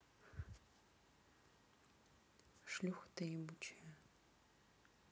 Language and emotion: Russian, neutral